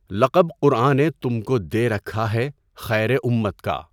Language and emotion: Urdu, neutral